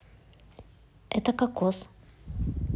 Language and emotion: Russian, neutral